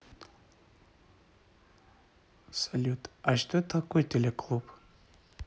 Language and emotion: Russian, neutral